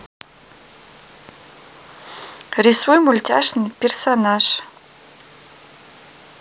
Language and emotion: Russian, positive